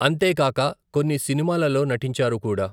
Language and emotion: Telugu, neutral